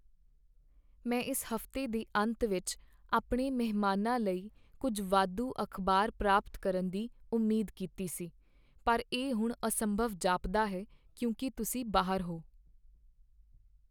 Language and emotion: Punjabi, sad